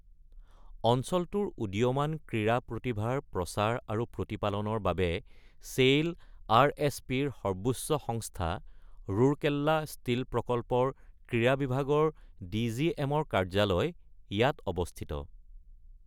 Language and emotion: Assamese, neutral